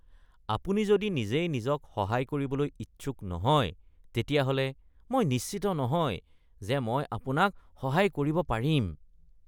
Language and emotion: Assamese, disgusted